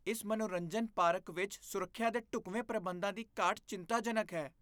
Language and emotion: Punjabi, disgusted